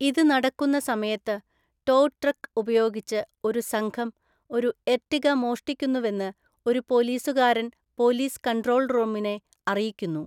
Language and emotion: Malayalam, neutral